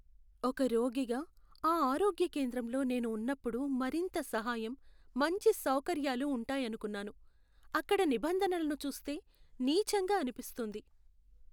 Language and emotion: Telugu, sad